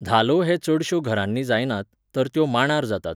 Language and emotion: Goan Konkani, neutral